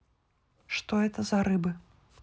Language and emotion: Russian, neutral